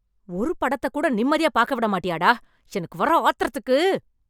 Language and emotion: Tamil, angry